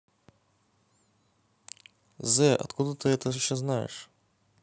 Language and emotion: Russian, neutral